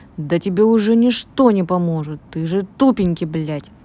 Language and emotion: Russian, angry